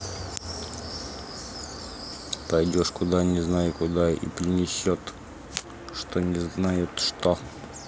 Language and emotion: Russian, neutral